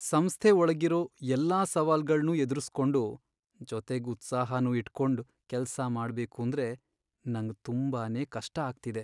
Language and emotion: Kannada, sad